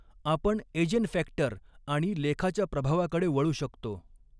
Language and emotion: Marathi, neutral